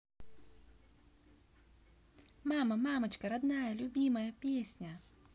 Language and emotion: Russian, positive